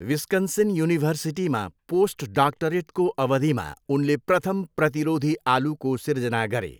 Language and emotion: Nepali, neutral